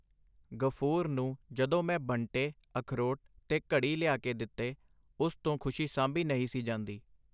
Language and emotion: Punjabi, neutral